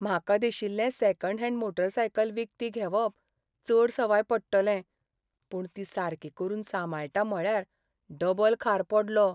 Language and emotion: Goan Konkani, sad